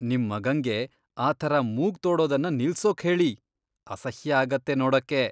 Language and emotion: Kannada, disgusted